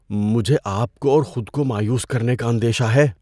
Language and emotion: Urdu, fearful